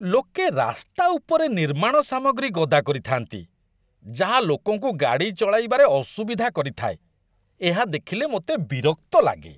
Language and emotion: Odia, disgusted